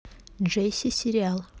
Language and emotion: Russian, neutral